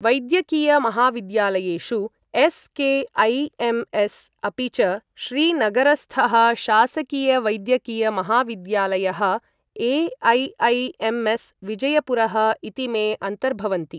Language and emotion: Sanskrit, neutral